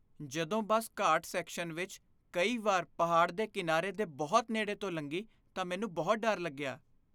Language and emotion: Punjabi, fearful